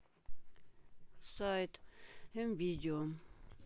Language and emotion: Russian, sad